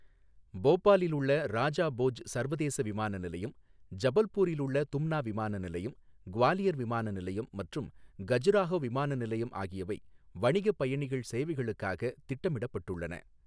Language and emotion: Tamil, neutral